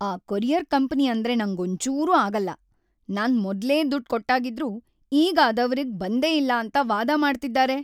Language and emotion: Kannada, angry